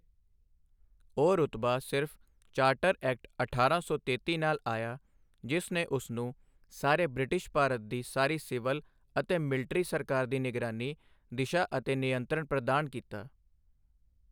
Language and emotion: Punjabi, neutral